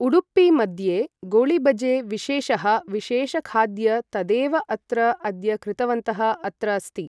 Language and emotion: Sanskrit, neutral